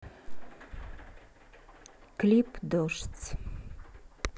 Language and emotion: Russian, neutral